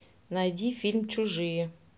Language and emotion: Russian, neutral